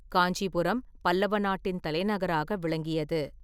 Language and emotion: Tamil, neutral